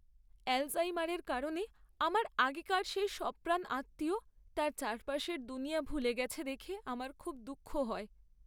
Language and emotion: Bengali, sad